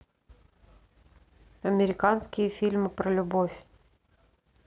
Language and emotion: Russian, neutral